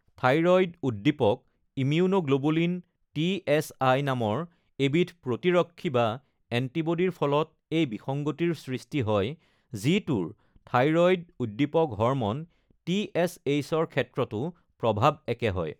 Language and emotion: Assamese, neutral